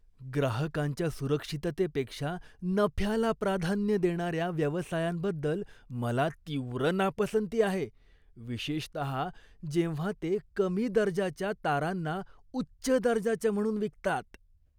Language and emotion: Marathi, disgusted